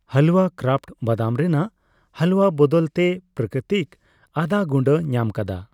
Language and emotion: Santali, neutral